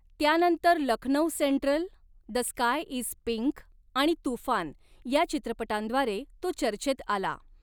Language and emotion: Marathi, neutral